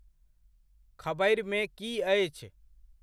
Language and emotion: Maithili, neutral